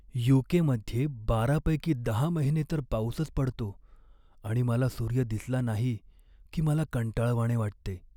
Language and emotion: Marathi, sad